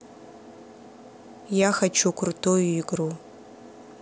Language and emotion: Russian, neutral